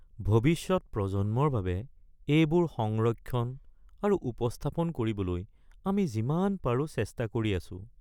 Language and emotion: Assamese, sad